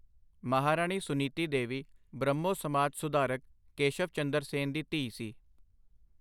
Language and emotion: Punjabi, neutral